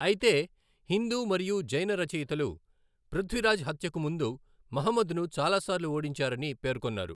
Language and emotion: Telugu, neutral